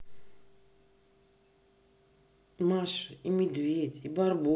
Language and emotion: Russian, neutral